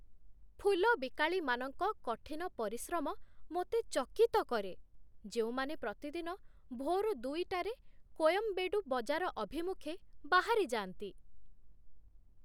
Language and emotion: Odia, surprised